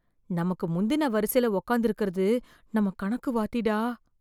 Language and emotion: Tamil, fearful